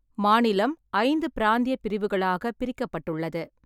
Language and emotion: Tamil, neutral